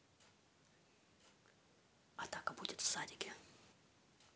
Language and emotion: Russian, neutral